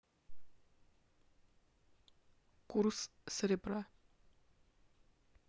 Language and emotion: Russian, neutral